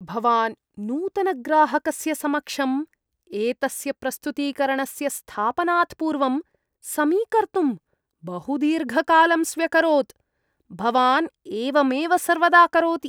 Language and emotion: Sanskrit, disgusted